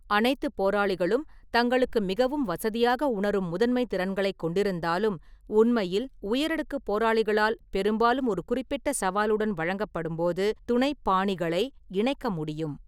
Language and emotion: Tamil, neutral